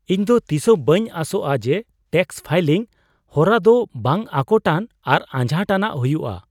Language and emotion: Santali, surprised